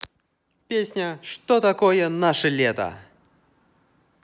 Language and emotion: Russian, positive